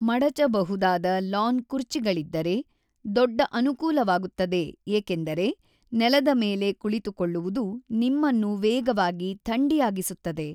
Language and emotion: Kannada, neutral